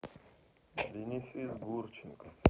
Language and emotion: Russian, neutral